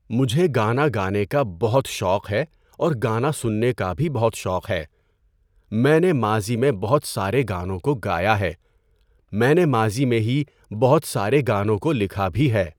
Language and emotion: Urdu, neutral